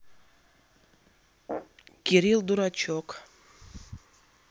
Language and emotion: Russian, neutral